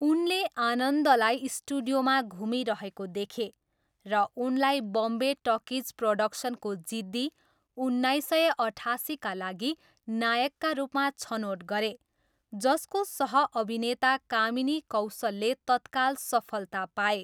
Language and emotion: Nepali, neutral